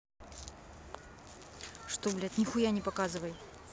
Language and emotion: Russian, angry